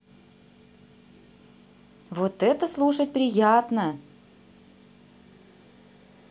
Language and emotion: Russian, positive